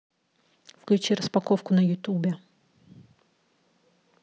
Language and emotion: Russian, neutral